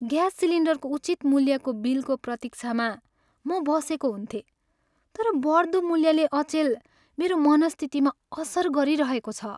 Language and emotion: Nepali, sad